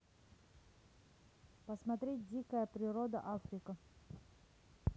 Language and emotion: Russian, neutral